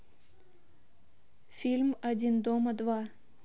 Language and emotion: Russian, neutral